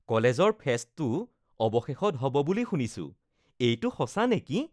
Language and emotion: Assamese, happy